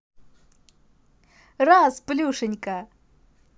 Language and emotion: Russian, positive